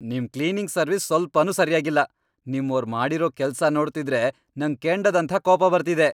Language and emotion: Kannada, angry